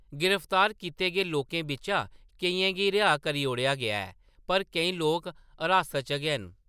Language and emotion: Dogri, neutral